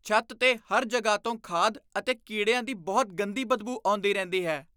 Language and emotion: Punjabi, disgusted